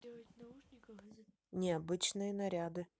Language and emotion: Russian, neutral